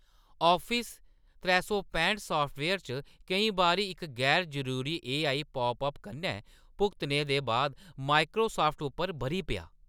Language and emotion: Dogri, angry